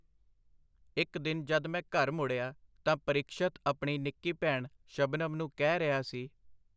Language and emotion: Punjabi, neutral